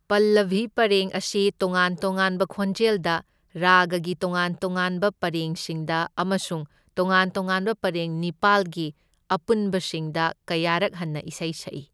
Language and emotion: Manipuri, neutral